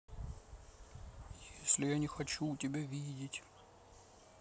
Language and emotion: Russian, sad